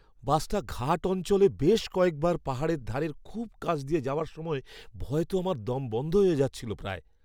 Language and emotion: Bengali, fearful